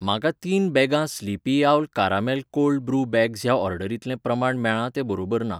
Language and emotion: Goan Konkani, neutral